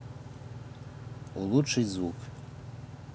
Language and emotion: Russian, neutral